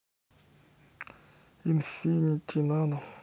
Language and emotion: Russian, neutral